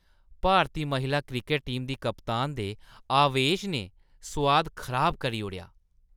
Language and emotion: Dogri, disgusted